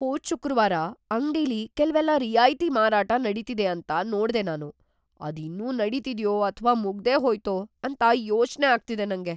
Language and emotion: Kannada, fearful